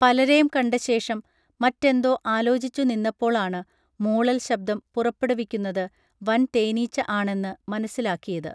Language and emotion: Malayalam, neutral